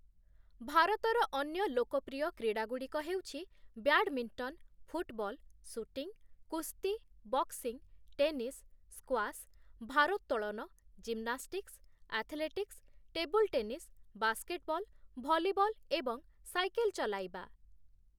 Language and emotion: Odia, neutral